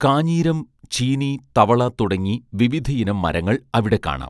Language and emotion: Malayalam, neutral